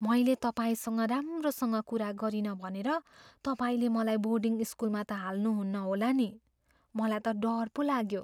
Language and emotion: Nepali, fearful